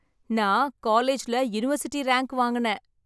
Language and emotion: Tamil, happy